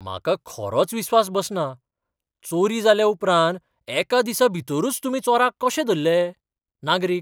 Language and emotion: Goan Konkani, surprised